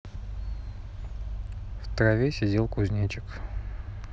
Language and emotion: Russian, neutral